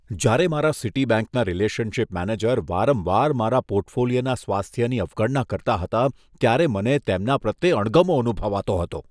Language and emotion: Gujarati, disgusted